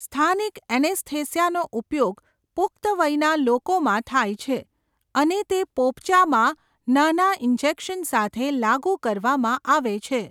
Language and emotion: Gujarati, neutral